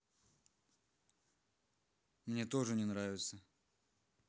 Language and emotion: Russian, neutral